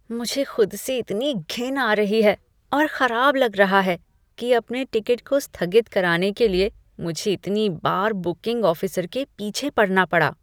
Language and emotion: Hindi, disgusted